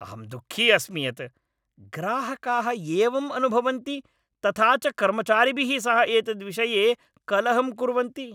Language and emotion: Sanskrit, angry